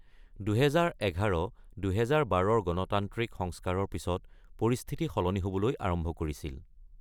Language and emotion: Assamese, neutral